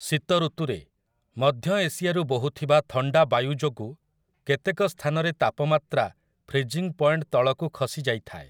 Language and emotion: Odia, neutral